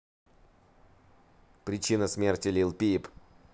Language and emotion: Russian, neutral